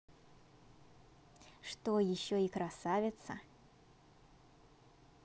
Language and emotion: Russian, positive